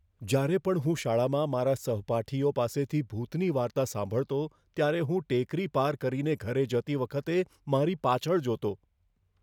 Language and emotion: Gujarati, fearful